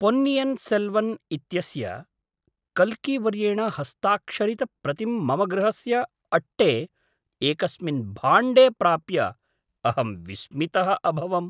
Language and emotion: Sanskrit, surprised